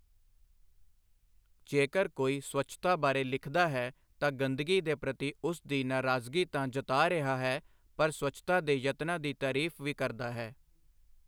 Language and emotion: Punjabi, neutral